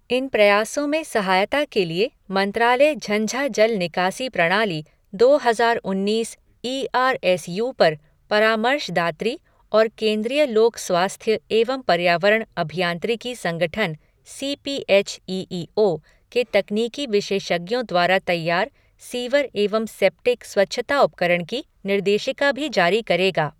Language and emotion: Hindi, neutral